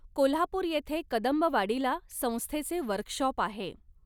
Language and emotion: Marathi, neutral